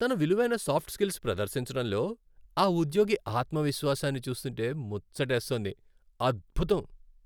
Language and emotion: Telugu, happy